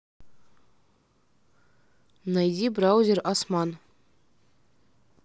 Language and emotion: Russian, neutral